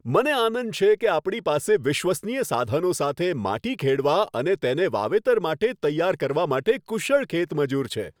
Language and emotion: Gujarati, happy